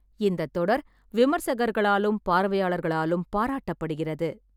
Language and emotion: Tamil, neutral